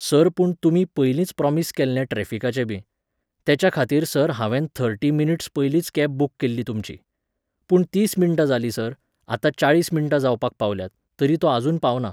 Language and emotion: Goan Konkani, neutral